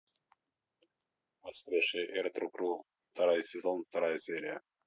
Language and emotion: Russian, neutral